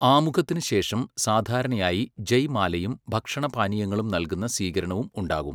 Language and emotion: Malayalam, neutral